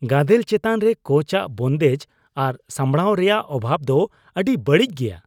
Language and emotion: Santali, disgusted